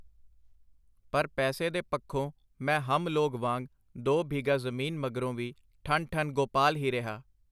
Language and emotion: Punjabi, neutral